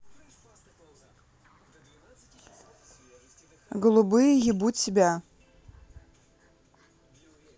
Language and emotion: Russian, neutral